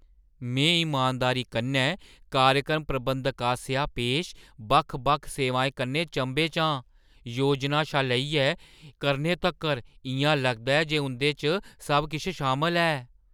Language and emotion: Dogri, surprised